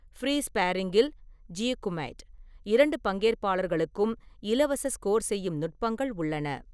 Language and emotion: Tamil, neutral